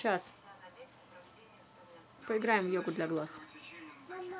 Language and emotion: Russian, neutral